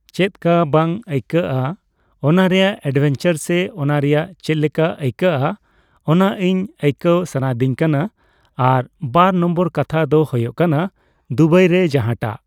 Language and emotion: Santali, neutral